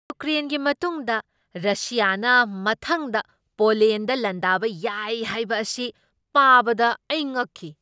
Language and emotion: Manipuri, surprised